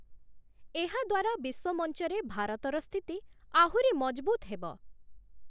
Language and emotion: Odia, neutral